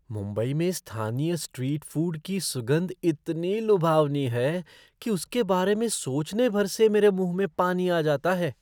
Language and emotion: Hindi, surprised